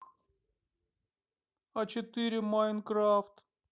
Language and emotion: Russian, sad